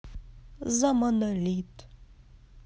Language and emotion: Russian, positive